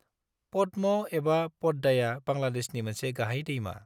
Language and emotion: Bodo, neutral